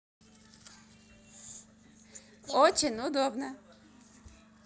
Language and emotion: Russian, positive